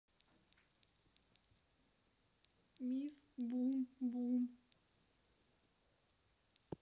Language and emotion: Russian, sad